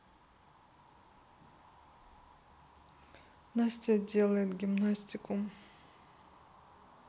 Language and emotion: Russian, neutral